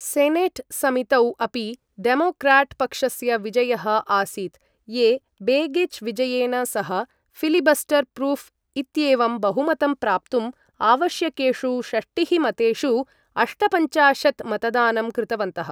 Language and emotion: Sanskrit, neutral